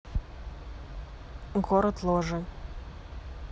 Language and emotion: Russian, neutral